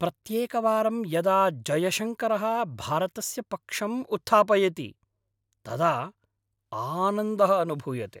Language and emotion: Sanskrit, happy